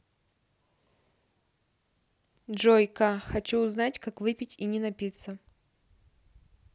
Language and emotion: Russian, neutral